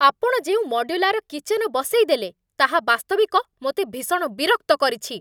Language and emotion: Odia, angry